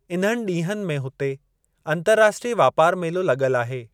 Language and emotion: Sindhi, neutral